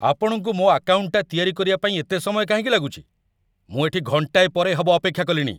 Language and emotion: Odia, angry